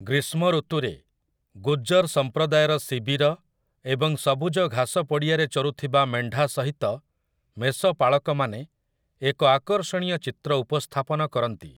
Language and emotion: Odia, neutral